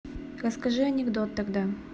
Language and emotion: Russian, neutral